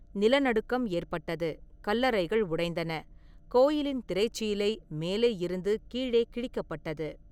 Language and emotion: Tamil, neutral